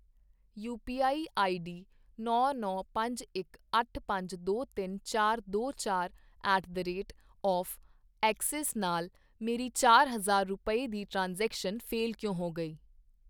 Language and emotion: Punjabi, neutral